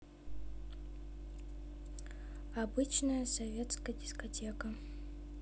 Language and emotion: Russian, neutral